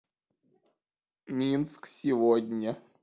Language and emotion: Russian, neutral